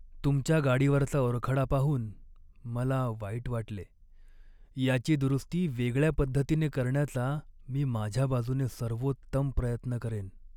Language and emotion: Marathi, sad